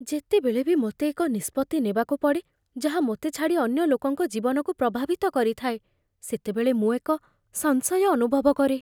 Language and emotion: Odia, fearful